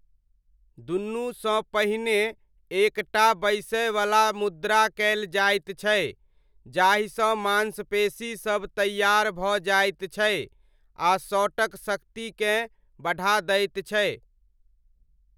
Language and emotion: Maithili, neutral